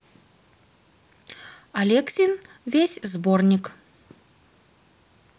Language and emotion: Russian, neutral